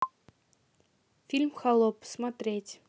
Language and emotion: Russian, neutral